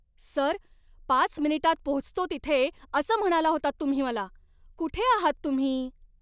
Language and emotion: Marathi, angry